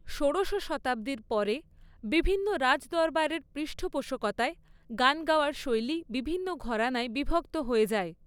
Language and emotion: Bengali, neutral